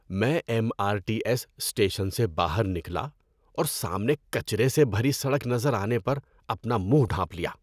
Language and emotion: Urdu, disgusted